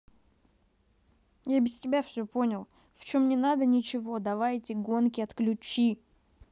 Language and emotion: Russian, angry